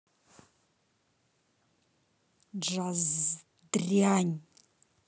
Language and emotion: Russian, angry